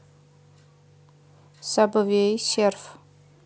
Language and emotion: Russian, neutral